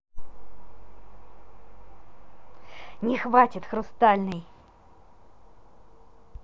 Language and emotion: Russian, angry